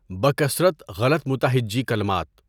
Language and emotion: Urdu, neutral